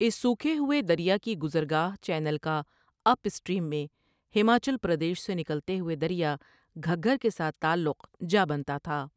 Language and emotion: Urdu, neutral